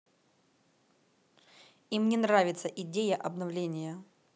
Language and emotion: Russian, angry